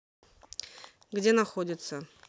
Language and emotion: Russian, neutral